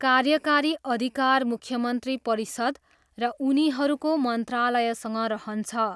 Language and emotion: Nepali, neutral